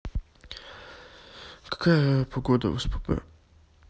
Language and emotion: Russian, sad